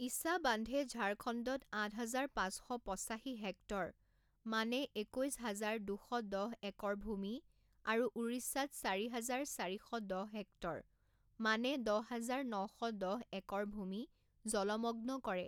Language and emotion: Assamese, neutral